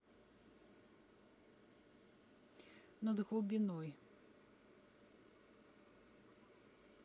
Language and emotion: Russian, neutral